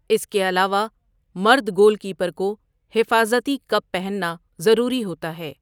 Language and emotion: Urdu, neutral